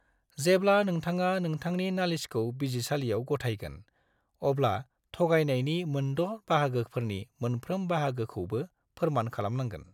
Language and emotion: Bodo, neutral